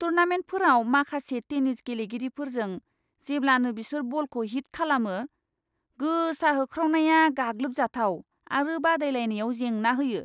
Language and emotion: Bodo, disgusted